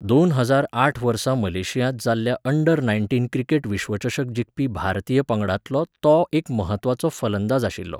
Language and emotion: Goan Konkani, neutral